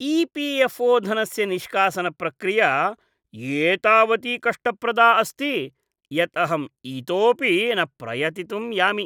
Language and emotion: Sanskrit, disgusted